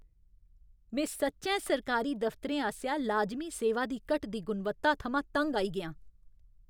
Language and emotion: Dogri, angry